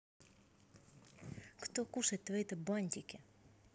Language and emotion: Russian, angry